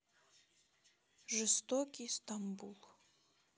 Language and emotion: Russian, sad